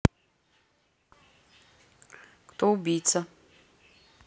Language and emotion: Russian, neutral